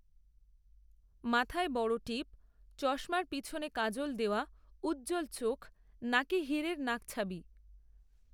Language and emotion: Bengali, neutral